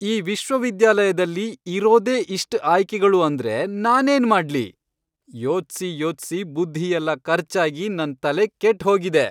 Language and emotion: Kannada, angry